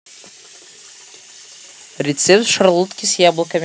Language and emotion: Russian, positive